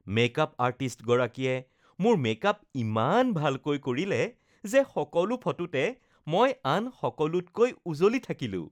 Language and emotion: Assamese, happy